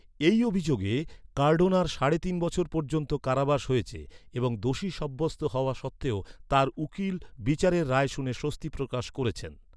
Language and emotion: Bengali, neutral